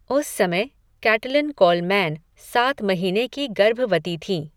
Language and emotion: Hindi, neutral